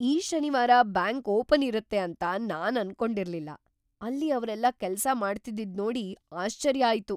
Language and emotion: Kannada, surprised